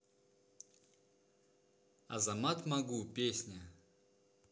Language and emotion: Russian, neutral